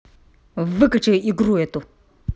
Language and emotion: Russian, angry